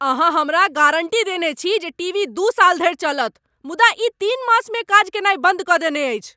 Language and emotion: Maithili, angry